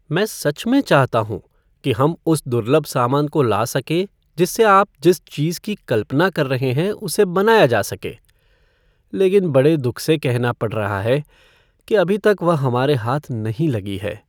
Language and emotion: Hindi, sad